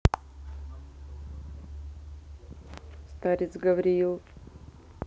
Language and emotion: Russian, neutral